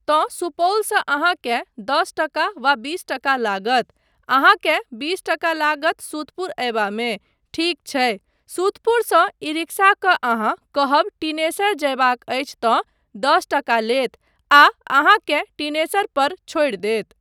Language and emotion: Maithili, neutral